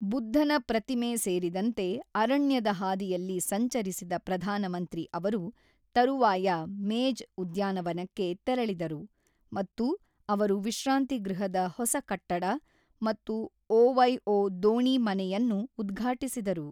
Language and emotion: Kannada, neutral